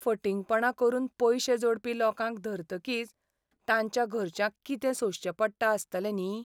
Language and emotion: Goan Konkani, sad